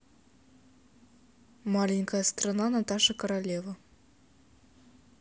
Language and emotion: Russian, neutral